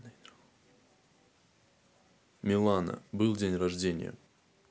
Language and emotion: Russian, neutral